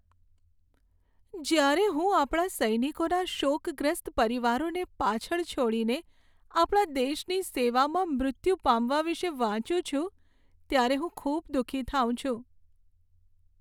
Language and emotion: Gujarati, sad